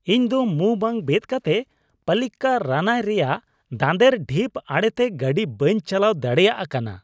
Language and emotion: Santali, disgusted